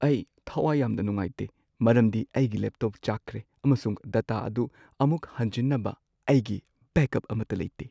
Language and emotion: Manipuri, sad